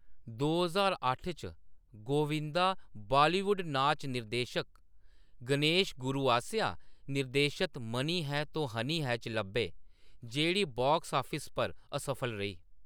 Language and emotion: Dogri, neutral